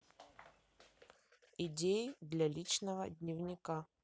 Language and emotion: Russian, neutral